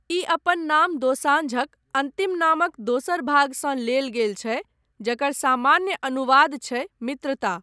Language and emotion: Maithili, neutral